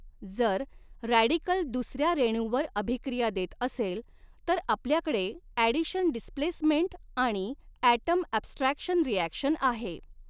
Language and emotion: Marathi, neutral